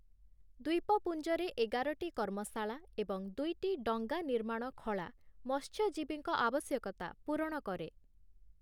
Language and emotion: Odia, neutral